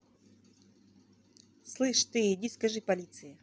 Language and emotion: Russian, angry